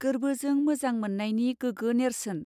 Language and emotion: Bodo, neutral